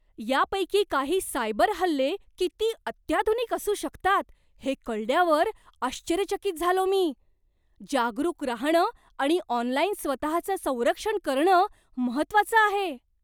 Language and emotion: Marathi, surprised